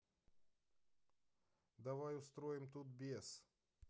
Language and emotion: Russian, neutral